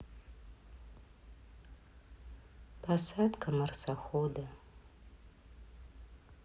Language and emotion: Russian, sad